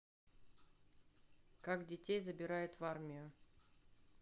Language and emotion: Russian, neutral